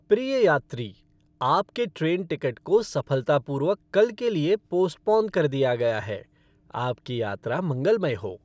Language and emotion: Hindi, happy